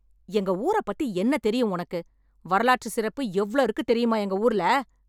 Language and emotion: Tamil, angry